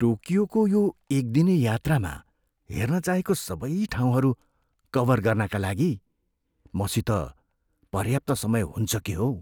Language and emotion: Nepali, fearful